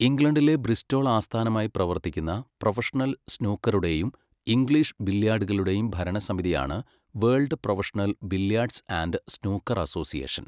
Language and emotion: Malayalam, neutral